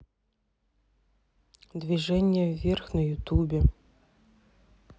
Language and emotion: Russian, neutral